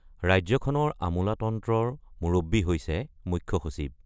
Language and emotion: Assamese, neutral